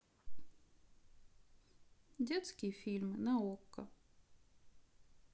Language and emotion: Russian, sad